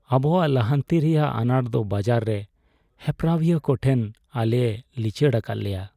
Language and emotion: Santali, sad